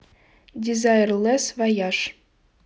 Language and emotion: Russian, neutral